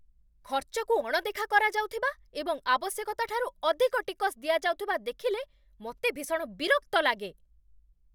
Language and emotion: Odia, angry